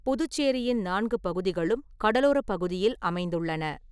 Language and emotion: Tamil, neutral